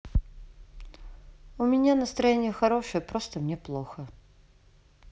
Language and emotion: Russian, sad